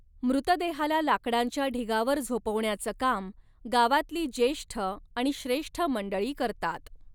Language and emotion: Marathi, neutral